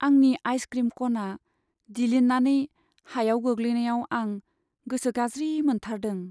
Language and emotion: Bodo, sad